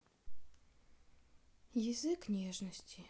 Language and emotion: Russian, sad